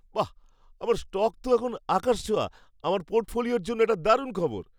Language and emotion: Bengali, happy